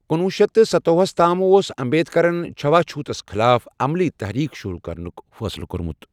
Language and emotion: Kashmiri, neutral